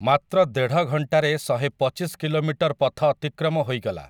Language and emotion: Odia, neutral